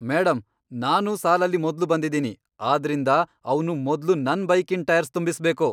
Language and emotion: Kannada, angry